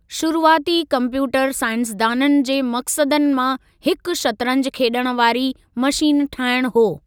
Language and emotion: Sindhi, neutral